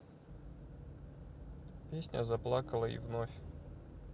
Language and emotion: Russian, neutral